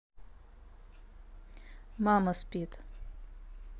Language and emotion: Russian, neutral